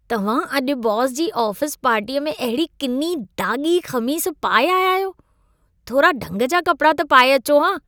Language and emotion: Sindhi, disgusted